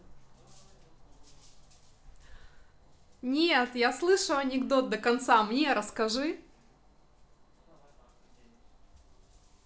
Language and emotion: Russian, positive